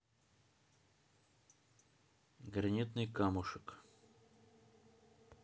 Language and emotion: Russian, neutral